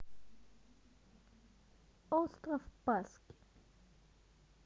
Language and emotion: Russian, neutral